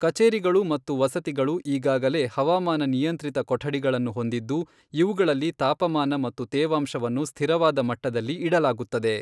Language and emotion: Kannada, neutral